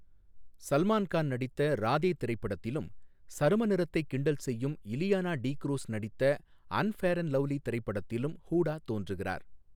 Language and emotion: Tamil, neutral